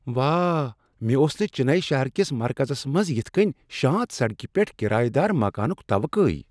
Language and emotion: Kashmiri, surprised